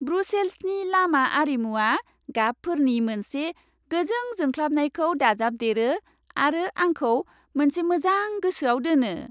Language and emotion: Bodo, happy